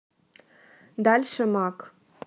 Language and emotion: Russian, neutral